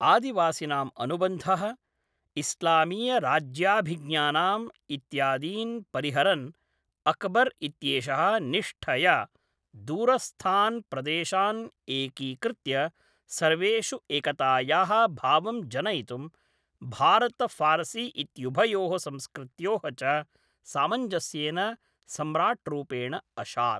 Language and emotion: Sanskrit, neutral